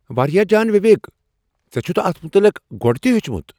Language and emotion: Kashmiri, surprised